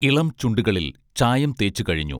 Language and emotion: Malayalam, neutral